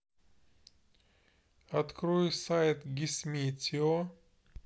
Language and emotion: Russian, neutral